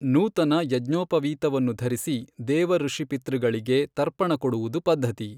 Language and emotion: Kannada, neutral